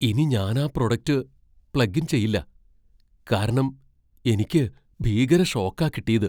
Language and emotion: Malayalam, fearful